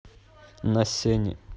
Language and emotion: Russian, neutral